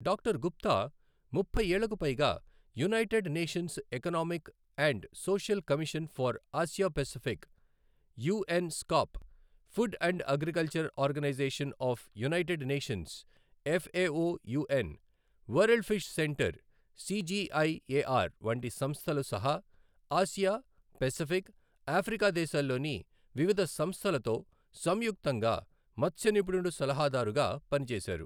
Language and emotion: Telugu, neutral